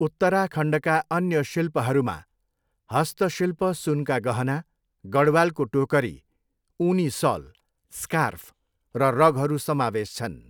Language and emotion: Nepali, neutral